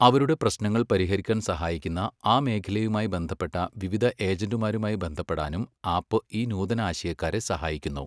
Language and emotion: Malayalam, neutral